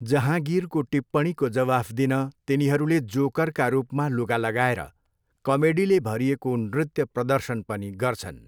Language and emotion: Nepali, neutral